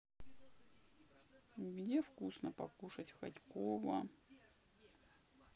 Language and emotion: Russian, sad